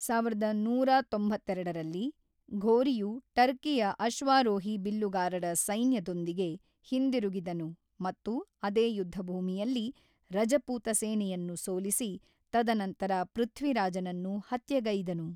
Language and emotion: Kannada, neutral